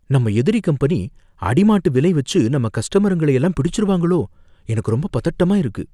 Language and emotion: Tamil, fearful